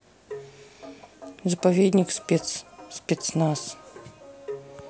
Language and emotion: Russian, neutral